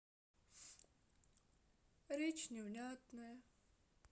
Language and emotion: Russian, sad